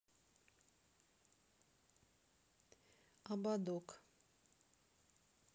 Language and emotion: Russian, neutral